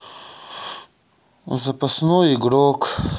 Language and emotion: Russian, sad